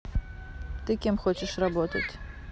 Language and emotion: Russian, neutral